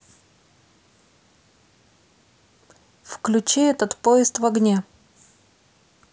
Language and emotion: Russian, neutral